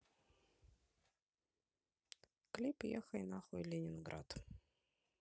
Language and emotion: Russian, neutral